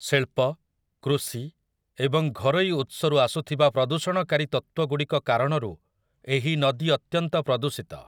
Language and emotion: Odia, neutral